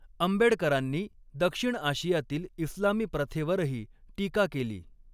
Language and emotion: Marathi, neutral